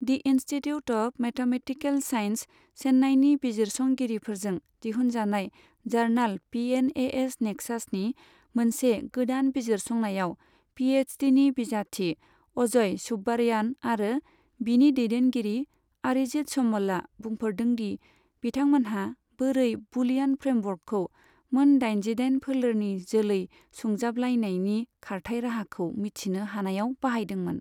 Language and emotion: Bodo, neutral